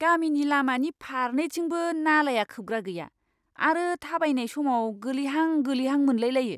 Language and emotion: Bodo, disgusted